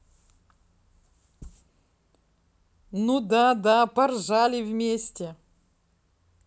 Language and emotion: Russian, positive